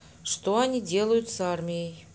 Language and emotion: Russian, neutral